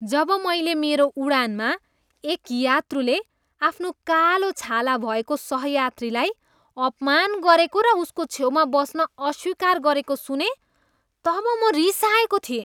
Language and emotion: Nepali, disgusted